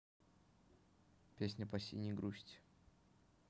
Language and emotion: Russian, neutral